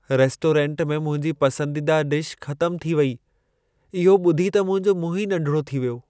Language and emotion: Sindhi, sad